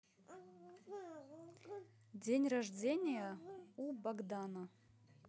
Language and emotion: Russian, neutral